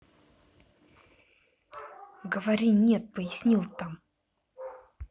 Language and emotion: Russian, angry